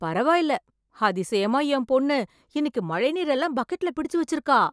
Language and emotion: Tamil, surprised